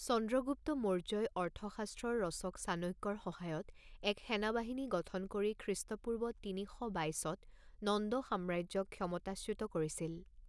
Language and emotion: Assamese, neutral